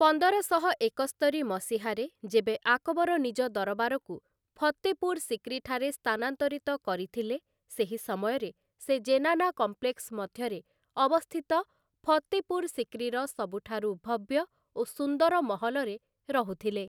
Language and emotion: Odia, neutral